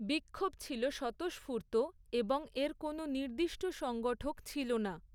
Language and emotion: Bengali, neutral